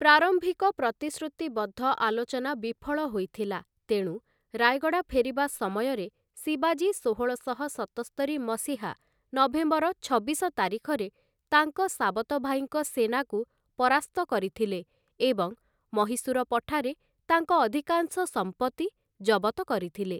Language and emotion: Odia, neutral